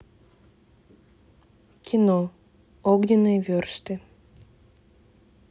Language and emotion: Russian, neutral